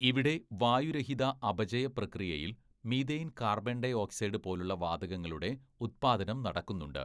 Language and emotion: Malayalam, neutral